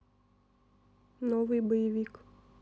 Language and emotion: Russian, neutral